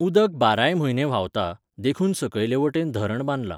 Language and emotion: Goan Konkani, neutral